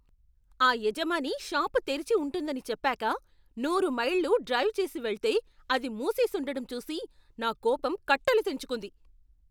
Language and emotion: Telugu, angry